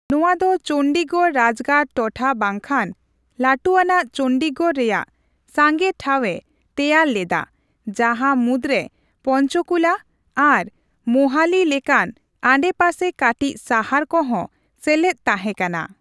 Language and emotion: Santali, neutral